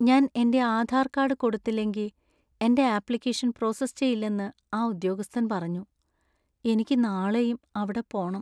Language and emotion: Malayalam, sad